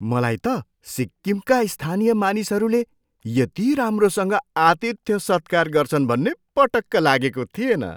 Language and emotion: Nepali, surprised